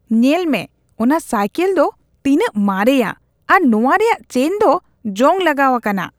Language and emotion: Santali, disgusted